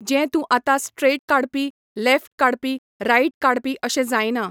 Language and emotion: Goan Konkani, neutral